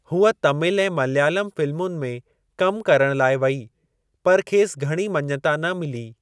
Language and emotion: Sindhi, neutral